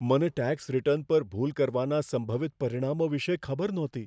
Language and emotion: Gujarati, fearful